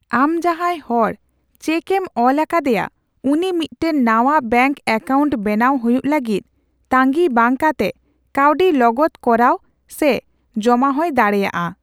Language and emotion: Santali, neutral